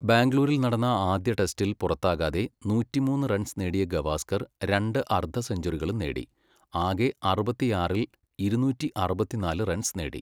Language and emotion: Malayalam, neutral